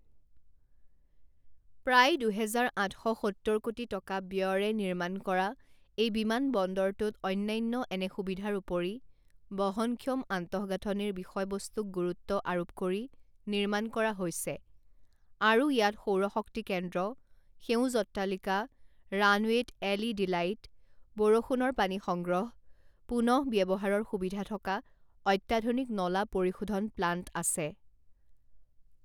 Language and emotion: Assamese, neutral